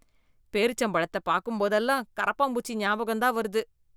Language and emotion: Tamil, disgusted